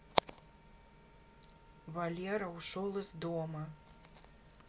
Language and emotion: Russian, neutral